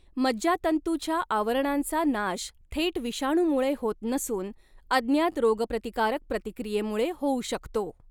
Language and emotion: Marathi, neutral